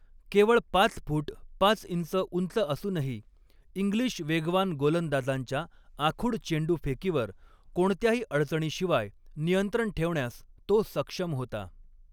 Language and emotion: Marathi, neutral